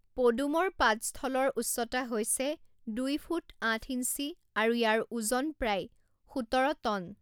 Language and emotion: Assamese, neutral